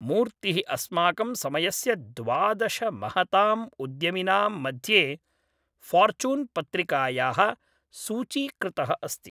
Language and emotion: Sanskrit, neutral